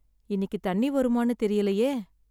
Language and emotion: Tamil, sad